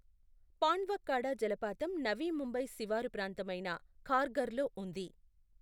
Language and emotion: Telugu, neutral